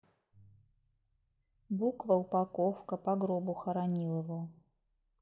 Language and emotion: Russian, neutral